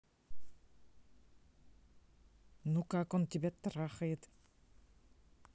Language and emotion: Russian, angry